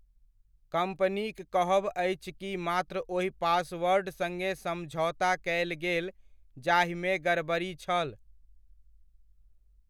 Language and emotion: Maithili, neutral